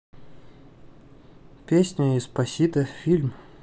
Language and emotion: Russian, neutral